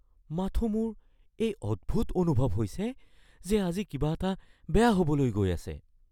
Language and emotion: Assamese, fearful